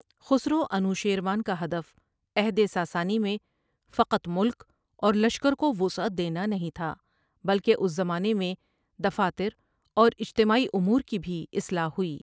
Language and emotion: Urdu, neutral